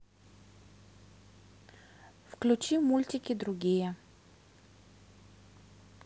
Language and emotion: Russian, neutral